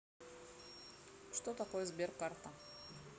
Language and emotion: Russian, neutral